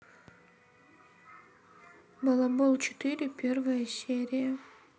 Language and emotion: Russian, sad